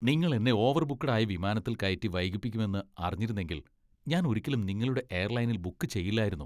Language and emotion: Malayalam, disgusted